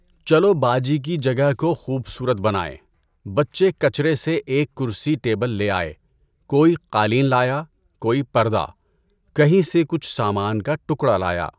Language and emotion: Urdu, neutral